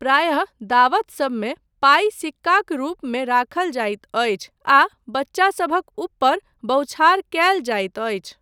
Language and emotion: Maithili, neutral